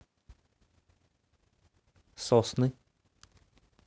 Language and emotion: Russian, neutral